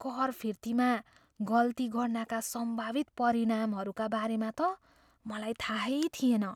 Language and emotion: Nepali, fearful